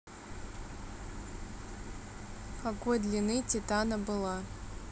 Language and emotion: Russian, neutral